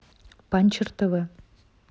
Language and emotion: Russian, neutral